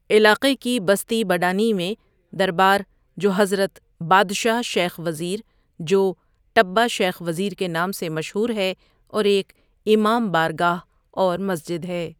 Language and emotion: Urdu, neutral